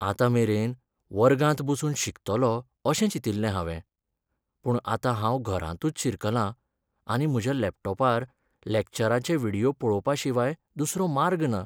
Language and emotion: Goan Konkani, sad